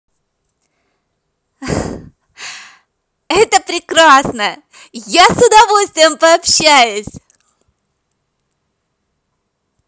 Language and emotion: Russian, positive